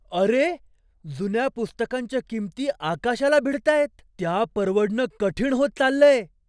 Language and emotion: Marathi, surprised